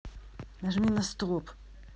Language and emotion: Russian, angry